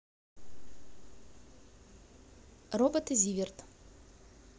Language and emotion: Russian, neutral